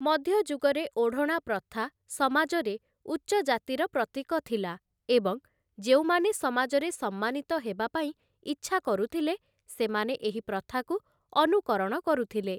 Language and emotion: Odia, neutral